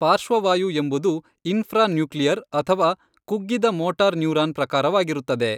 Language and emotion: Kannada, neutral